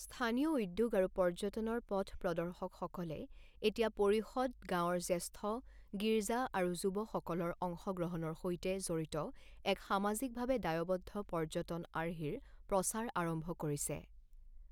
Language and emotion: Assamese, neutral